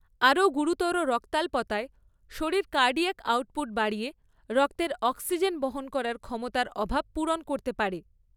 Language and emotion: Bengali, neutral